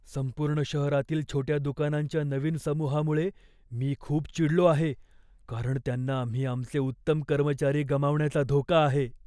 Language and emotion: Marathi, fearful